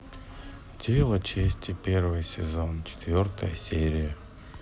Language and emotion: Russian, sad